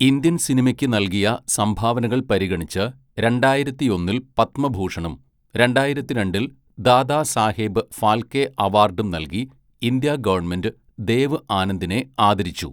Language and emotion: Malayalam, neutral